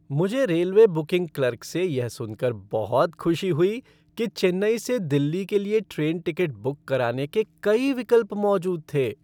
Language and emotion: Hindi, happy